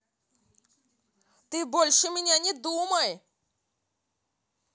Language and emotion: Russian, angry